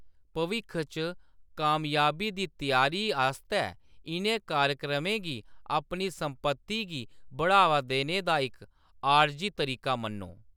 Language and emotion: Dogri, neutral